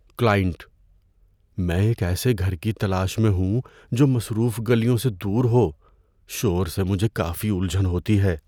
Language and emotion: Urdu, fearful